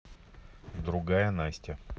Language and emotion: Russian, neutral